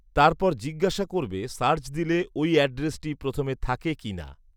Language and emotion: Bengali, neutral